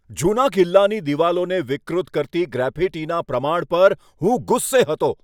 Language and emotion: Gujarati, angry